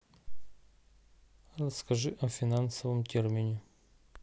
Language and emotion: Russian, neutral